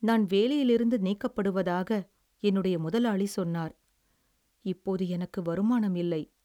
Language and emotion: Tamil, sad